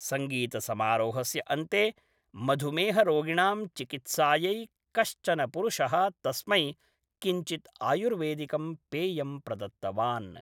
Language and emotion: Sanskrit, neutral